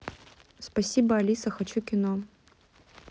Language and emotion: Russian, neutral